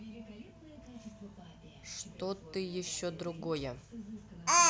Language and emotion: Russian, neutral